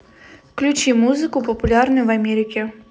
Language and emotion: Russian, neutral